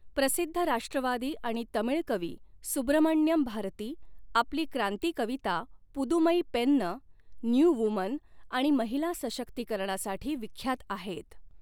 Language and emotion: Marathi, neutral